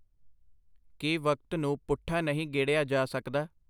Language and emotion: Punjabi, neutral